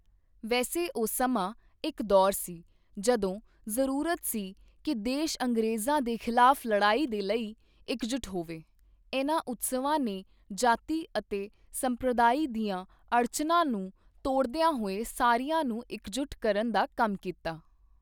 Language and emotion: Punjabi, neutral